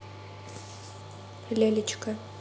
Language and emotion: Russian, neutral